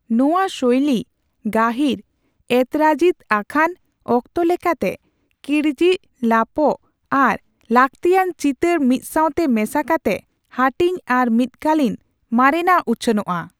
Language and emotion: Santali, neutral